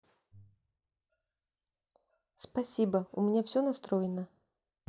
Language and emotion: Russian, neutral